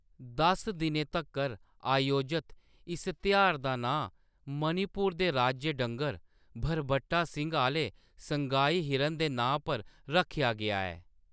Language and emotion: Dogri, neutral